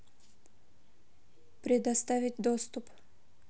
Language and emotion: Russian, neutral